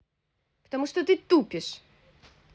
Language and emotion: Russian, angry